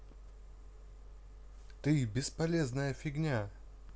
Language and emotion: Russian, neutral